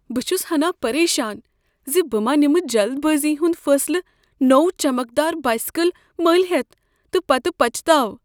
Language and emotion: Kashmiri, fearful